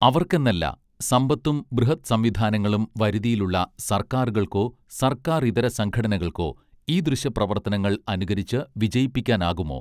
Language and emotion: Malayalam, neutral